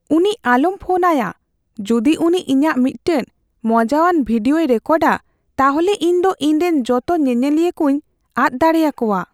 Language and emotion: Santali, fearful